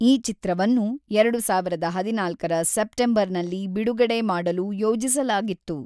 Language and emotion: Kannada, neutral